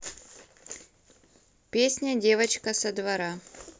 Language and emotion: Russian, neutral